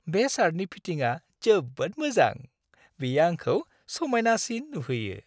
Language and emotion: Bodo, happy